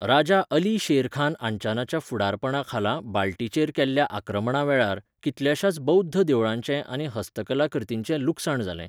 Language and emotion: Goan Konkani, neutral